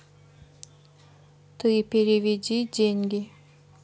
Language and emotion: Russian, neutral